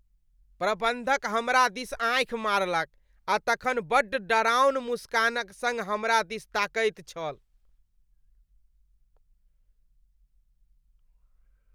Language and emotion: Maithili, disgusted